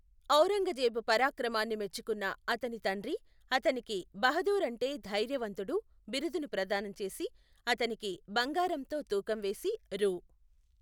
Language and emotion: Telugu, neutral